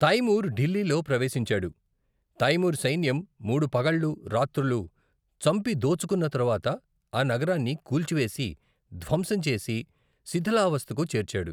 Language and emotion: Telugu, neutral